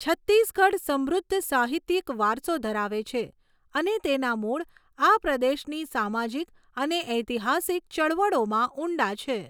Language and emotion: Gujarati, neutral